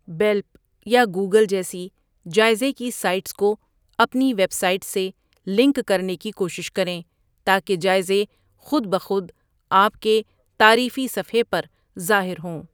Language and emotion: Urdu, neutral